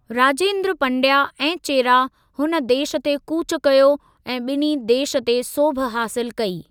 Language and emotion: Sindhi, neutral